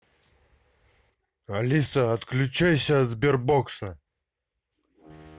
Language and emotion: Russian, angry